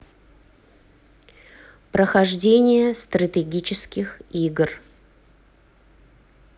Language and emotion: Russian, neutral